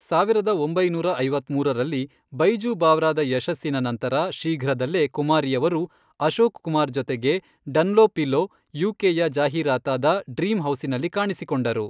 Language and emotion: Kannada, neutral